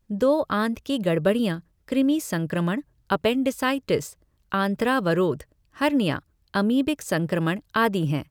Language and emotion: Hindi, neutral